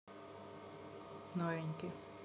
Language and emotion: Russian, neutral